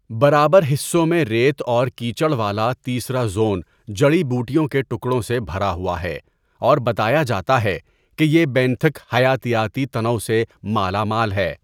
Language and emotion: Urdu, neutral